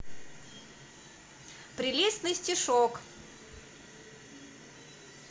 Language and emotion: Russian, positive